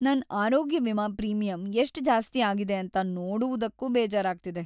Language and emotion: Kannada, sad